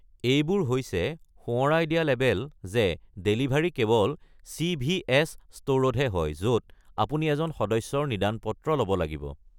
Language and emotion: Assamese, neutral